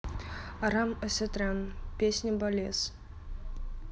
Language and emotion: Russian, neutral